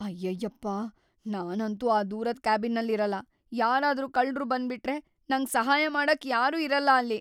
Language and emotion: Kannada, fearful